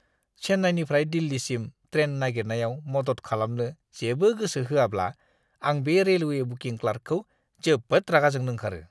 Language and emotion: Bodo, disgusted